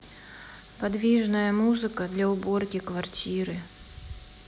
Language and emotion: Russian, sad